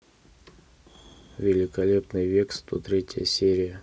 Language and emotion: Russian, neutral